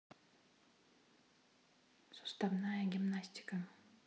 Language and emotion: Russian, neutral